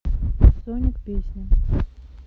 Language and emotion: Russian, neutral